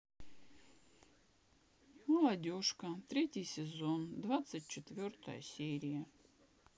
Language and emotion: Russian, sad